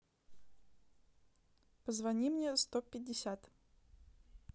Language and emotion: Russian, neutral